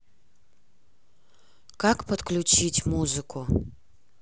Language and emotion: Russian, neutral